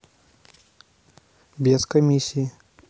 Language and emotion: Russian, neutral